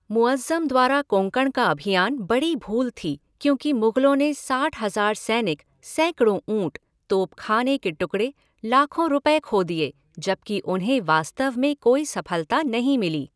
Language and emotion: Hindi, neutral